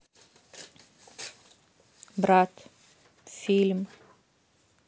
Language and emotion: Russian, neutral